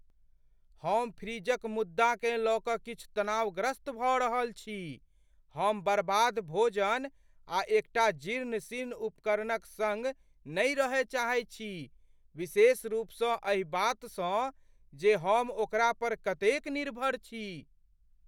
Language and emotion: Maithili, fearful